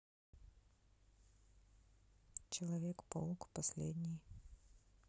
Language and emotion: Russian, neutral